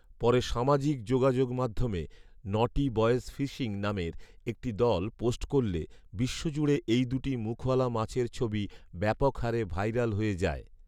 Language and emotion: Bengali, neutral